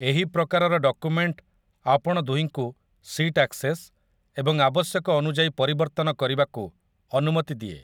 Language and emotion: Odia, neutral